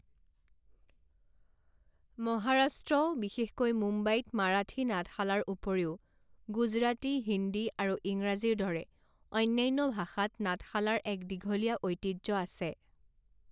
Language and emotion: Assamese, neutral